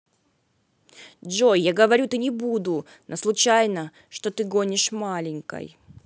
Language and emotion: Russian, sad